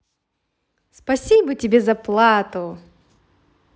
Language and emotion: Russian, positive